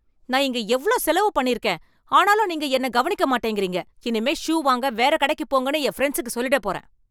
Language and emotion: Tamil, angry